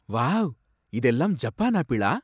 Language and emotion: Tamil, surprised